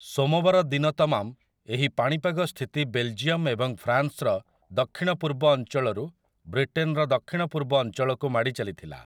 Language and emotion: Odia, neutral